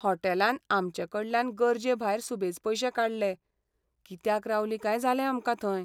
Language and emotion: Goan Konkani, sad